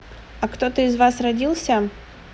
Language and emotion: Russian, neutral